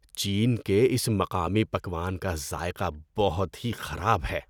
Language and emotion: Urdu, disgusted